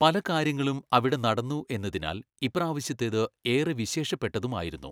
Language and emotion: Malayalam, neutral